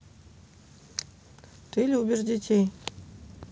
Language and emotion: Russian, neutral